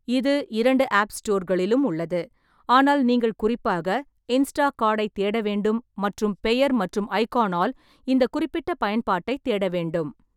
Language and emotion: Tamil, neutral